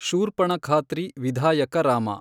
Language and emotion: Kannada, neutral